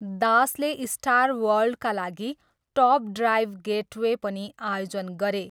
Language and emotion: Nepali, neutral